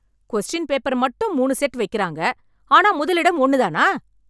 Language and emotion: Tamil, angry